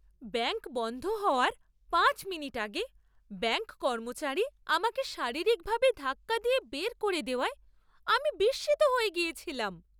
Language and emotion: Bengali, surprised